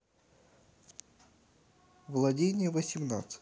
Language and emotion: Russian, neutral